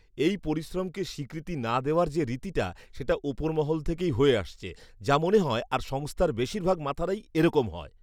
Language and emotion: Bengali, disgusted